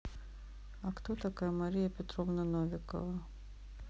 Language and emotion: Russian, neutral